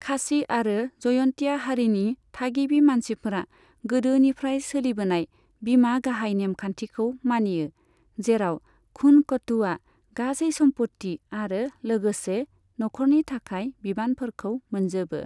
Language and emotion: Bodo, neutral